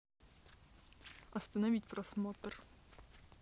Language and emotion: Russian, neutral